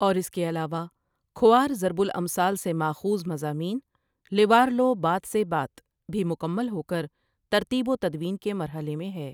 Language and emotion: Urdu, neutral